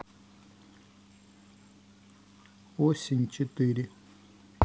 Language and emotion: Russian, neutral